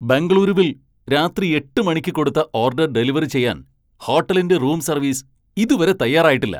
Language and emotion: Malayalam, angry